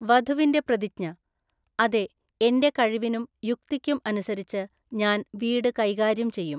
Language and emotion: Malayalam, neutral